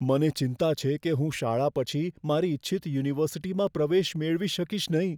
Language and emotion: Gujarati, fearful